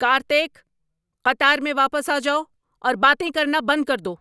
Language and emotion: Urdu, angry